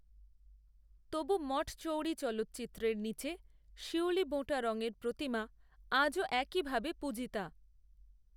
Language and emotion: Bengali, neutral